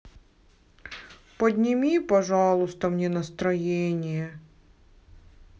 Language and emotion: Russian, sad